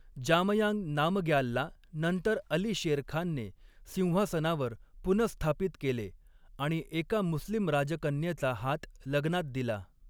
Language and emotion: Marathi, neutral